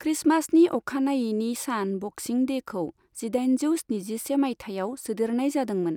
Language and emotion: Bodo, neutral